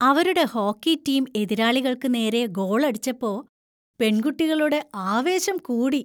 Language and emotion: Malayalam, happy